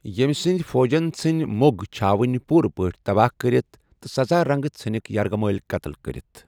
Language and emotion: Kashmiri, neutral